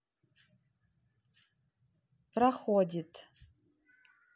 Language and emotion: Russian, neutral